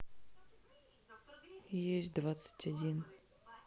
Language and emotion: Russian, sad